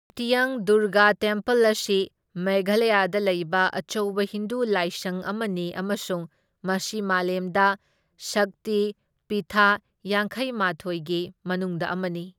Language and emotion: Manipuri, neutral